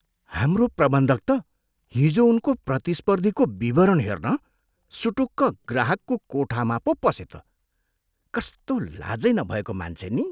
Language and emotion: Nepali, disgusted